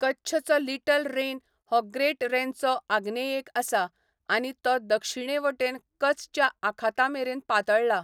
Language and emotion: Goan Konkani, neutral